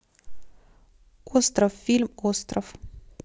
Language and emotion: Russian, neutral